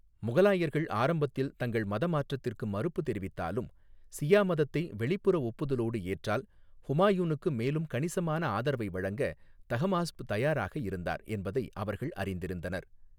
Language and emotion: Tamil, neutral